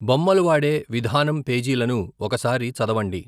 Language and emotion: Telugu, neutral